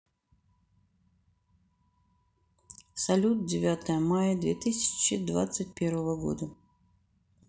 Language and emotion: Russian, neutral